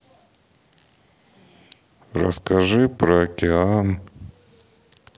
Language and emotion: Russian, sad